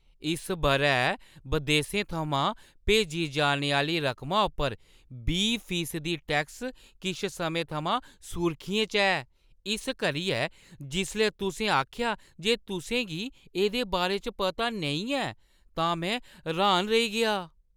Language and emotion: Dogri, surprised